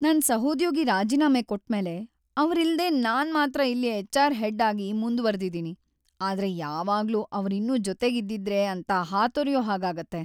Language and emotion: Kannada, sad